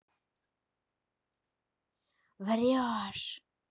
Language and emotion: Russian, angry